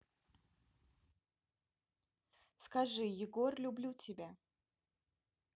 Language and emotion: Russian, neutral